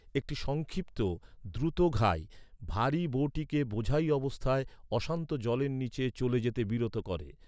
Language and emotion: Bengali, neutral